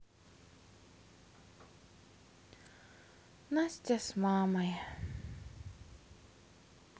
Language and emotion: Russian, sad